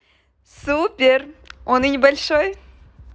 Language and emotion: Russian, positive